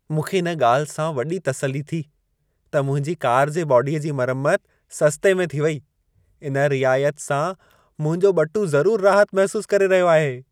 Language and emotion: Sindhi, happy